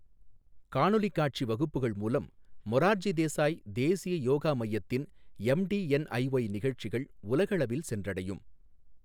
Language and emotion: Tamil, neutral